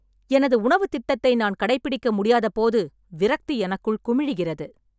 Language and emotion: Tamil, angry